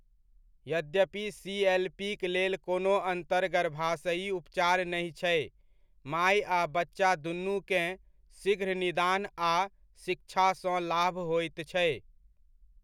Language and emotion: Maithili, neutral